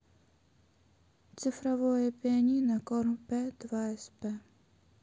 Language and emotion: Russian, sad